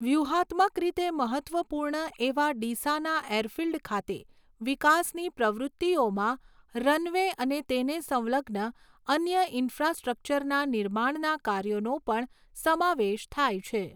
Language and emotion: Gujarati, neutral